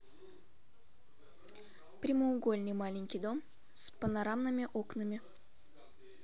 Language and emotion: Russian, neutral